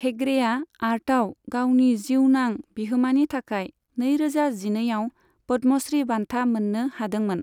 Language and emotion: Bodo, neutral